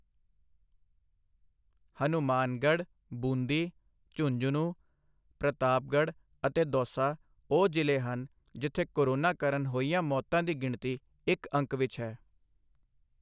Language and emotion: Punjabi, neutral